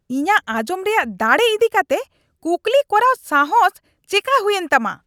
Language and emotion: Santali, angry